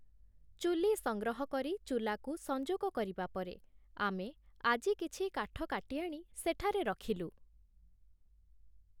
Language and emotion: Odia, neutral